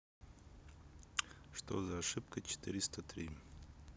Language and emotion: Russian, neutral